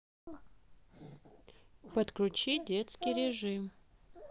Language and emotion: Russian, neutral